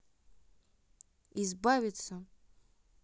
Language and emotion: Russian, neutral